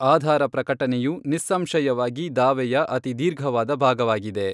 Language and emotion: Kannada, neutral